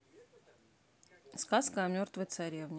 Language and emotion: Russian, neutral